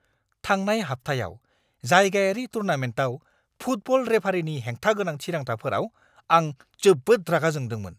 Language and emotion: Bodo, angry